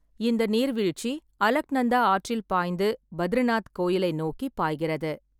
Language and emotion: Tamil, neutral